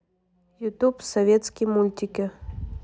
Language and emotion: Russian, neutral